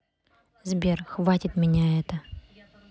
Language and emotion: Russian, angry